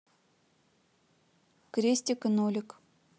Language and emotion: Russian, neutral